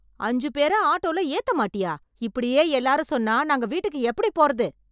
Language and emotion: Tamil, angry